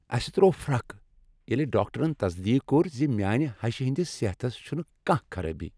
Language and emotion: Kashmiri, happy